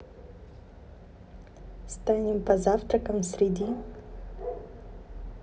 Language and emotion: Russian, neutral